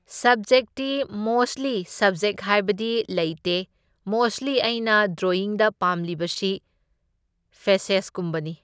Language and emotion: Manipuri, neutral